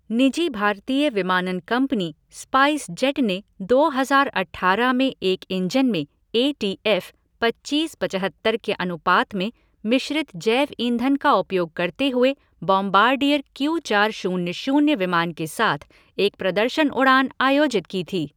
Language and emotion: Hindi, neutral